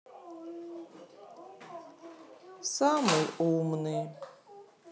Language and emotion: Russian, sad